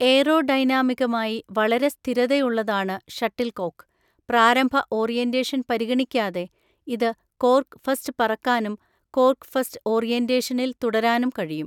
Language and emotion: Malayalam, neutral